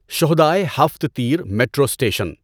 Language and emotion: Urdu, neutral